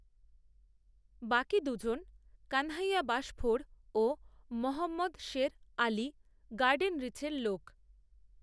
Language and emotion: Bengali, neutral